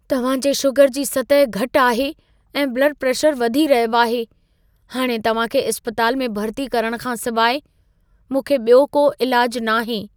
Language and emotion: Sindhi, fearful